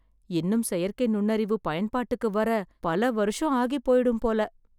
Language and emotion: Tamil, sad